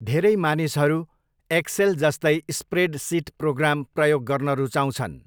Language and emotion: Nepali, neutral